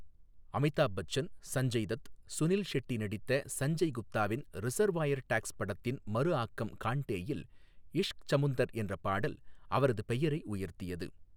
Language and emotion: Tamil, neutral